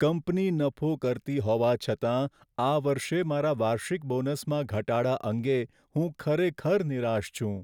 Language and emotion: Gujarati, sad